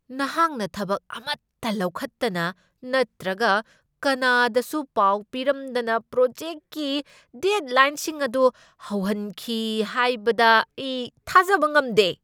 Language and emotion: Manipuri, angry